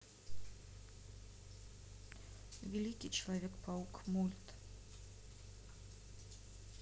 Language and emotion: Russian, neutral